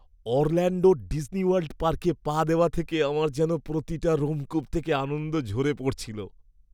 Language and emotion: Bengali, happy